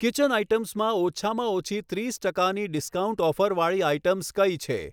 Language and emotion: Gujarati, neutral